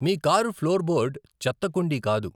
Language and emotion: Telugu, neutral